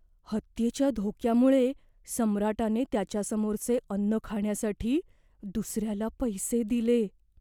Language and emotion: Marathi, fearful